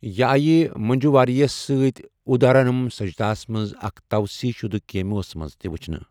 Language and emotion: Kashmiri, neutral